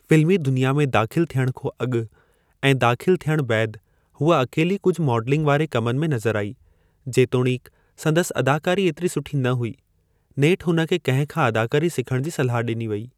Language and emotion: Sindhi, neutral